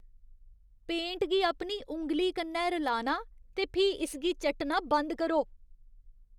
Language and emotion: Dogri, disgusted